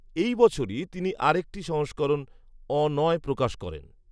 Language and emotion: Bengali, neutral